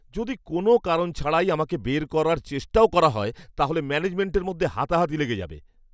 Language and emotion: Bengali, angry